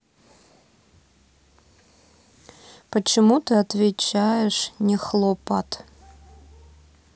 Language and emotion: Russian, neutral